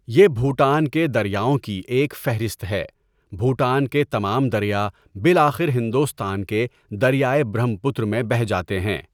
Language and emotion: Urdu, neutral